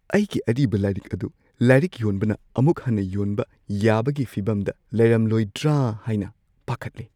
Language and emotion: Manipuri, fearful